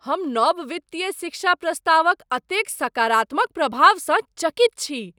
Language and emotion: Maithili, surprised